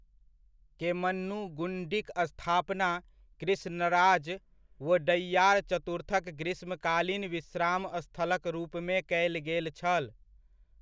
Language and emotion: Maithili, neutral